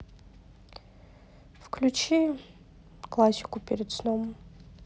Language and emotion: Russian, sad